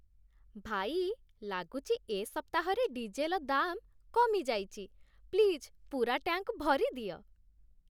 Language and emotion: Odia, happy